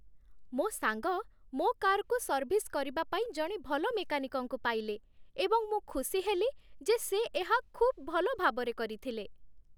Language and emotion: Odia, happy